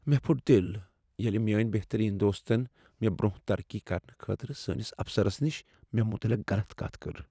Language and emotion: Kashmiri, sad